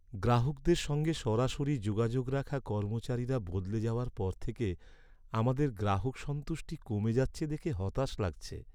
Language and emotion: Bengali, sad